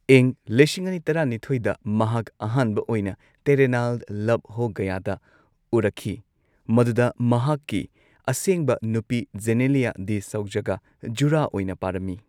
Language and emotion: Manipuri, neutral